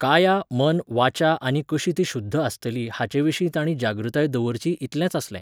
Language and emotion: Goan Konkani, neutral